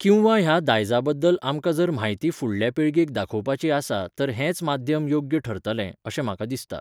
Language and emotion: Goan Konkani, neutral